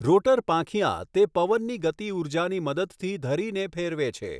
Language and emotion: Gujarati, neutral